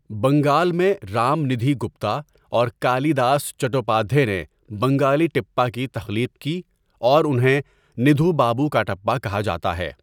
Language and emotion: Urdu, neutral